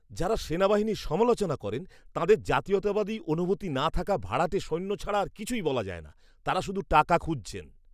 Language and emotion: Bengali, disgusted